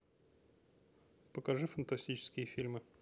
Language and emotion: Russian, neutral